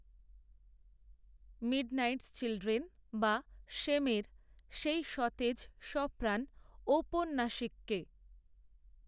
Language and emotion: Bengali, neutral